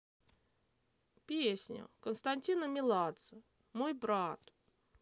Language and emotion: Russian, sad